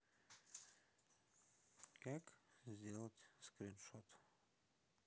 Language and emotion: Russian, sad